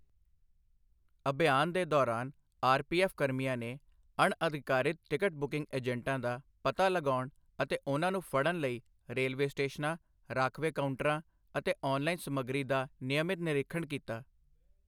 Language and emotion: Punjabi, neutral